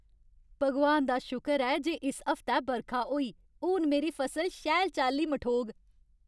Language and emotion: Dogri, happy